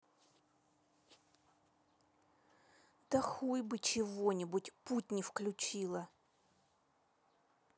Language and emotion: Russian, angry